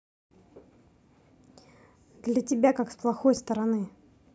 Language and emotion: Russian, angry